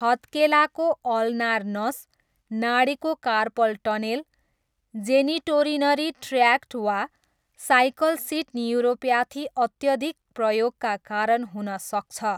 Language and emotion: Nepali, neutral